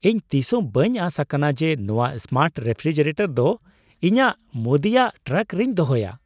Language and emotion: Santali, surprised